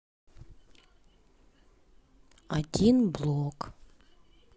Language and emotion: Russian, sad